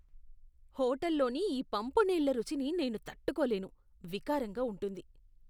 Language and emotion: Telugu, disgusted